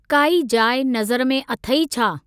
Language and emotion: Sindhi, neutral